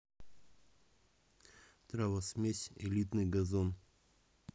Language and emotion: Russian, neutral